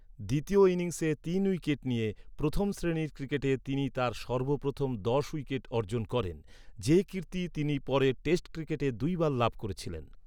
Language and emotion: Bengali, neutral